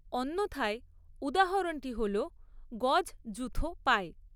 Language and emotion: Bengali, neutral